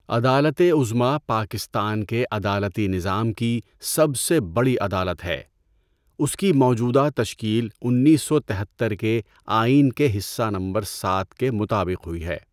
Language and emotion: Urdu, neutral